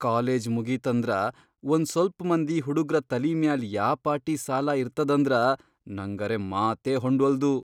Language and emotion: Kannada, surprised